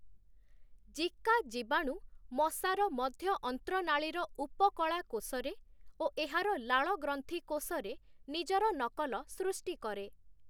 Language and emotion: Odia, neutral